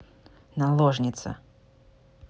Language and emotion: Russian, neutral